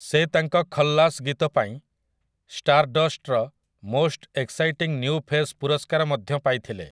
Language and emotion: Odia, neutral